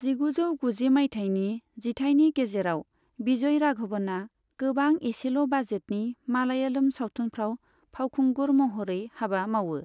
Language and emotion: Bodo, neutral